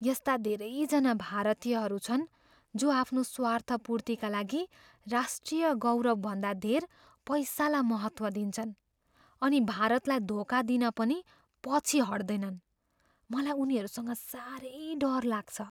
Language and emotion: Nepali, fearful